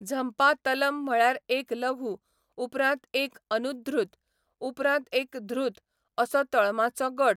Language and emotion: Goan Konkani, neutral